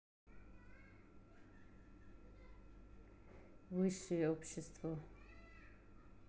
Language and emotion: Russian, neutral